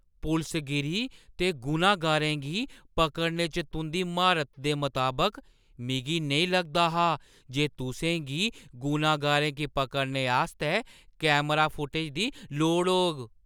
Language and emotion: Dogri, surprised